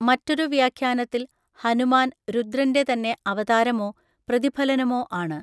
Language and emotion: Malayalam, neutral